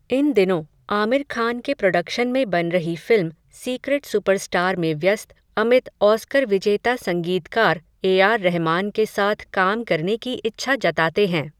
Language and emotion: Hindi, neutral